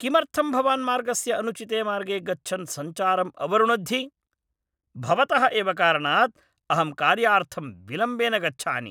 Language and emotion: Sanskrit, angry